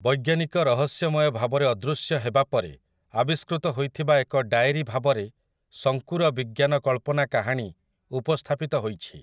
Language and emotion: Odia, neutral